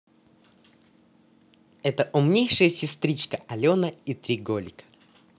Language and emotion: Russian, positive